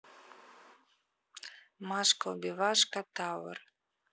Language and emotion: Russian, neutral